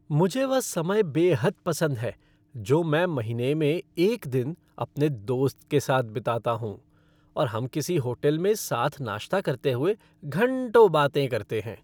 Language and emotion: Hindi, happy